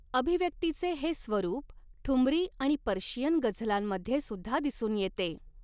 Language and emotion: Marathi, neutral